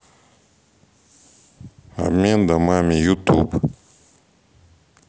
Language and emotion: Russian, neutral